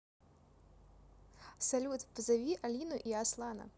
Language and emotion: Russian, positive